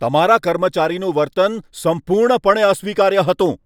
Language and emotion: Gujarati, angry